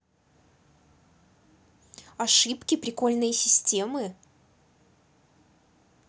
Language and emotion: Russian, neutral